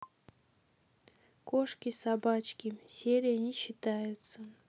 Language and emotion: Russian, neutral